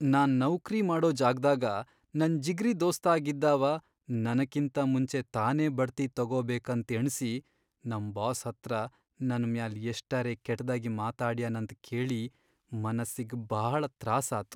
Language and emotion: Kannada, sad